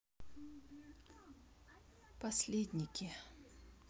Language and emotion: Russian, sad